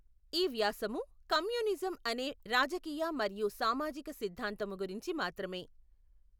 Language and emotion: Telugu, neutral